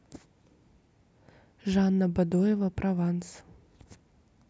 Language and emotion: Russian, neutral